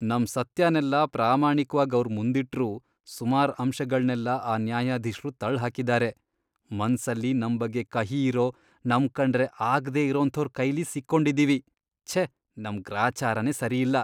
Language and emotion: Kannada, disgusted